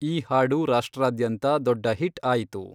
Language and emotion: Kannada, neutral